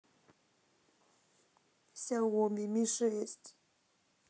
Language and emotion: Russian, sad